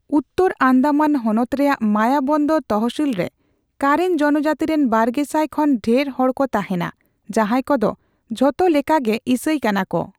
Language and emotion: Santali, neutral